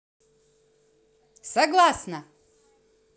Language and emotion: Russian, positive